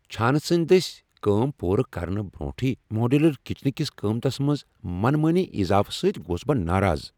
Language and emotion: Kashmiri, angry